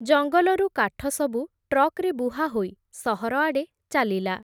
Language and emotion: Odia, neutral